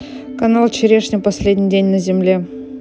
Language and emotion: Russian, neutral